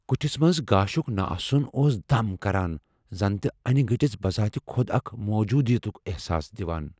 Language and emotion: Kashmiri, fearful